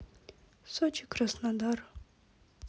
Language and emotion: Russian, sad